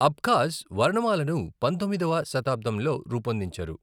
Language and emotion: Telugu, neutral